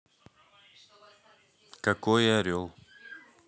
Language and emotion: Russian, neutral